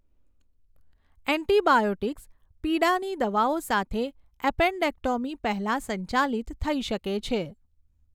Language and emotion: Gujarati, neutral